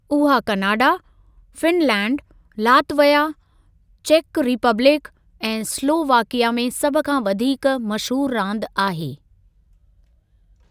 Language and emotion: Sindhi, neutral